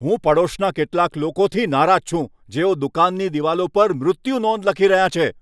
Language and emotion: Gujarati, angry